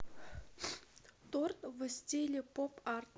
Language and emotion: Russian, neutral